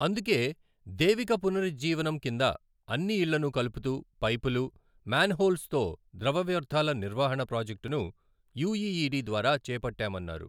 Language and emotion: Telugu, neutral